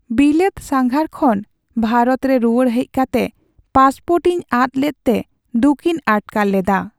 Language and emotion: Santali, sad